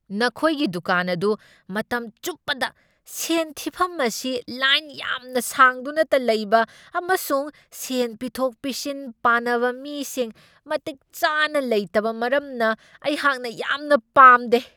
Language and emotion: Manipuri, angry